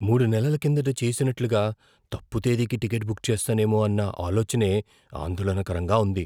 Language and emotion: Telugu, fearful